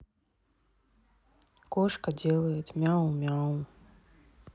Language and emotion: Russian, sad